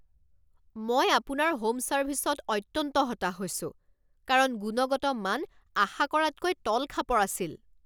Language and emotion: Assamese, angry